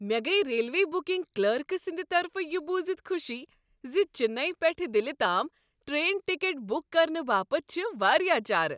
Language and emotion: Kashmiri, happy